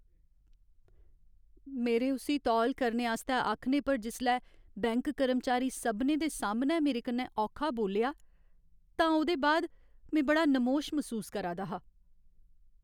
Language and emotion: Dogri, sad